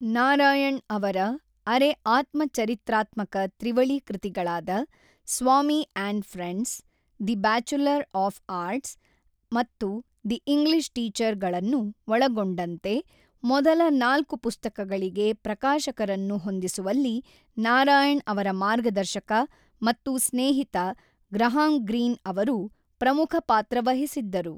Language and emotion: Kannada, neutral